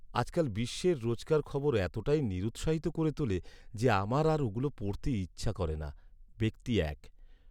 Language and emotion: Bengali, sad